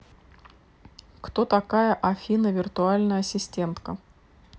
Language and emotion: Russian, neutral